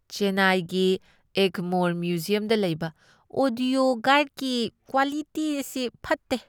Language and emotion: Manipuri, disgusted